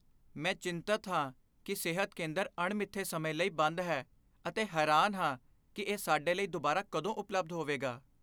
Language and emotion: Punjabi, fearful